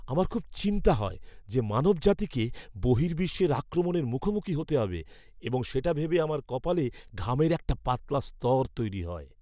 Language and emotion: Bengali, fearful